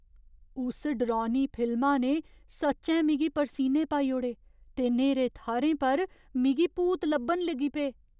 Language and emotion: Dogri, fearful